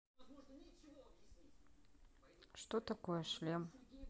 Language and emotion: Russian, neutral